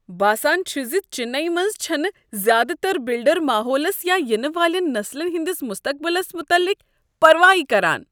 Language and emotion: Kashmiri, disgusted